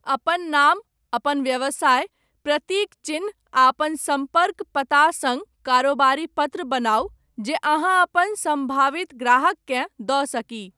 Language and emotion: Maithili, neutral